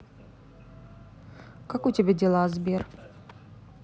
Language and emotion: Russian, neutral